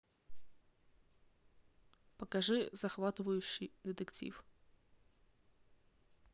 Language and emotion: Russian, neutral